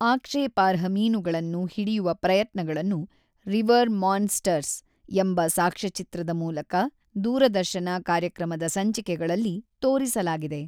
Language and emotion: Kannada, neutral